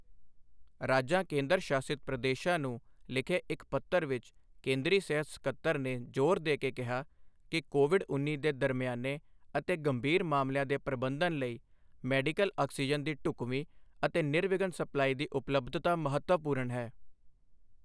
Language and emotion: Punjabi, neutral